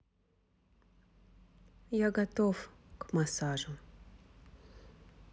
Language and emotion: Russian, neutral